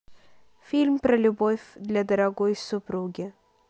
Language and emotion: Russian, neutral